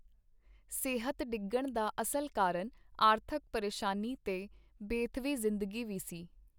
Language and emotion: Punjabi, neutral